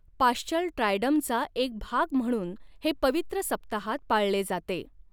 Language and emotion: Marathi, neutral